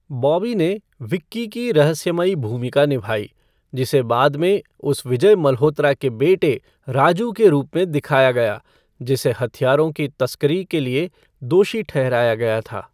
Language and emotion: Hindi, neutral